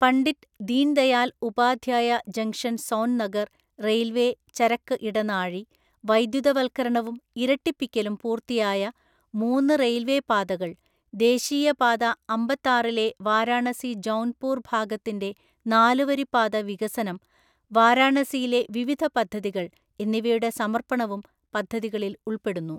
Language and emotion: Malayalam, neutral